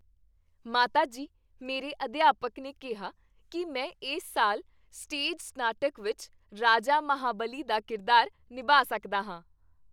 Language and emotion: Punjabi, happy